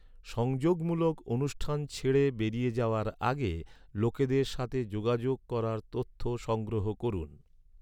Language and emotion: Bengali, neutral